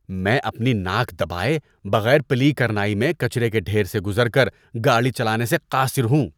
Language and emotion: Urdu, disgusted